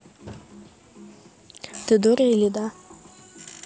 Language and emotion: Russian, neutral